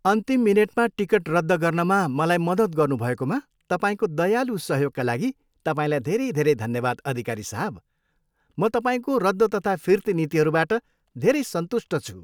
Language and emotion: Nepali, happy